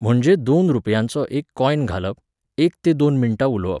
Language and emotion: Goan Konkani, neutral